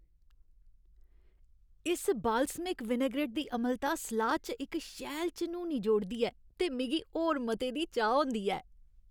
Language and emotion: Dogri, happy